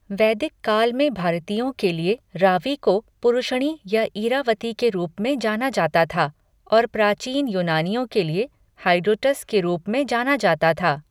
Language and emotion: Hindi, neutral